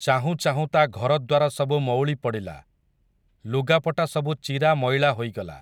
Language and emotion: Odia, neutral